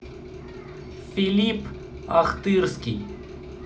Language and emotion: Russian, neutral